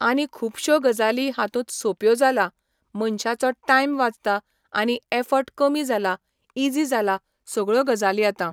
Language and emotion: Goan Konkani, neutral